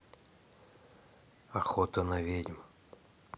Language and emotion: Russian, neutral